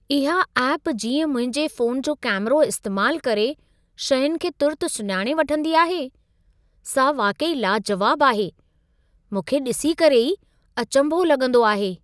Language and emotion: Sindhi, surprised